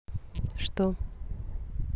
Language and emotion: Russian, neutral